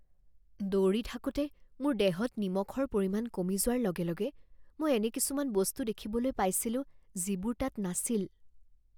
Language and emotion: Assamese, fearful